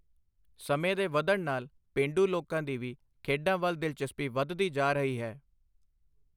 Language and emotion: Punjabi, neutral